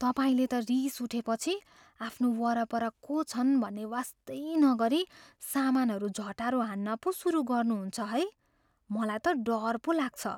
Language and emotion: Nepali, fearful